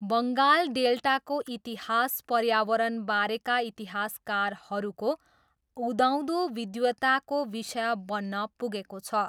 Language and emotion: Nepali, neutral